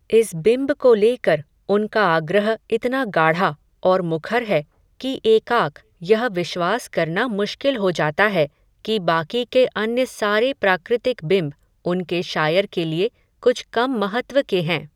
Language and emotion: Hindi, neutral